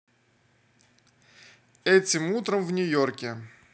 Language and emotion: Russian, neutral